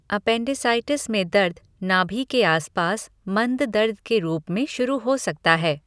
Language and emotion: Hindi, neutral